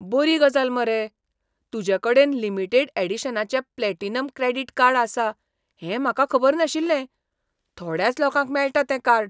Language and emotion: Goan Konkani, surprised